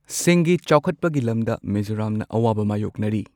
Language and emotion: Manipuri, neutral